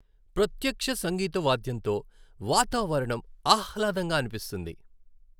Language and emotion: Telugu, happy